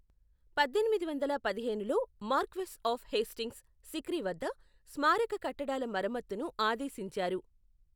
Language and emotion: Telugu, neutral